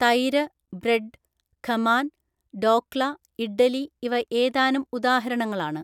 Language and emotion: Malayalam, neutral